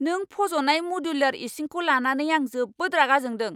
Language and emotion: Bodo, angry